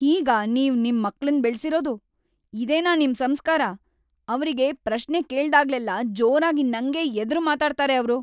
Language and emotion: Kannada, angry